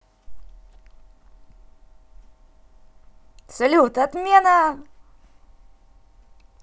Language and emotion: Russian, positive